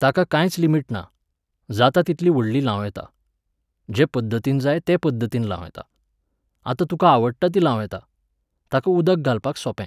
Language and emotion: Goan Konkani, neutral